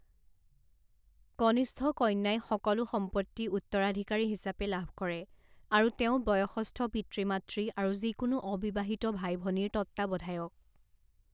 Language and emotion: Assamese, neutral